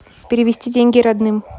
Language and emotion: Russian, neutral